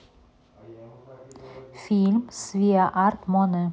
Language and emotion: Russian, neutral